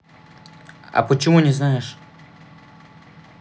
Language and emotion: Russian, neutral